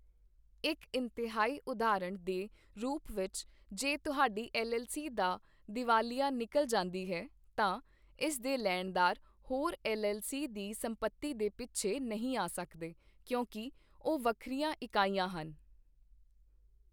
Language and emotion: Punjabi, neutral